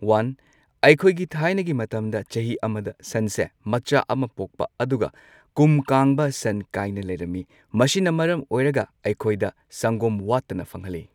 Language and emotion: Manipuri, neutral